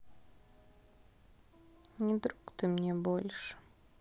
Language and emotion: Russian, sad